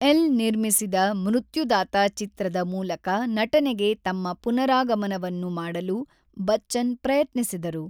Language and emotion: Kannada, neutral